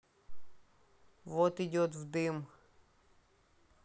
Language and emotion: Russian, neutral